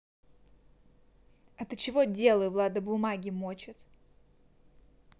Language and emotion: Russian, angry